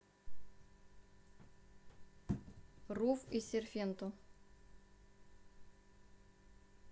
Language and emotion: Russian, neutral